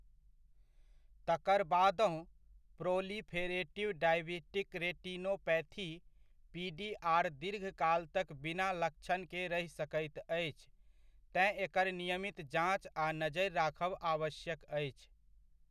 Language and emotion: Maithili, neutral